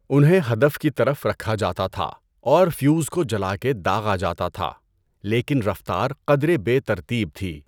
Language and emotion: Urdu, neutral